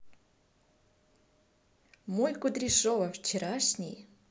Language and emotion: Russian, positive